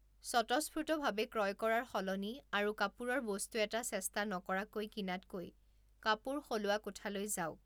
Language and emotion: Assamese, neutral